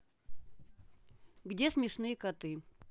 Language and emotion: Russian, neutral